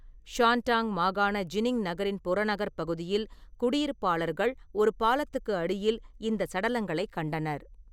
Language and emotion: Tamil, neutral